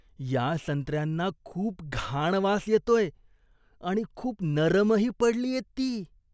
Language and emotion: Marathi, disgusted